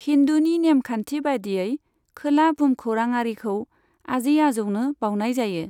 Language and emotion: Bodo, neutral